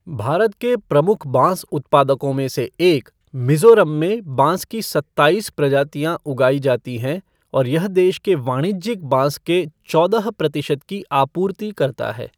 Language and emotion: Hindi, neutral